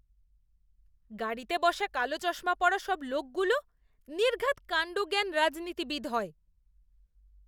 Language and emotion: Bengali, disgusted